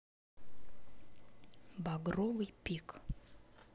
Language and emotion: Russian, neutral